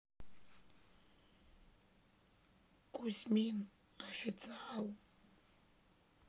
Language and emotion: Russian, sad